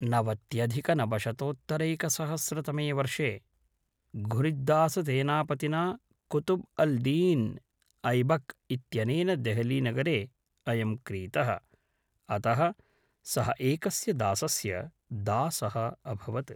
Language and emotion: Sanskrit, neutral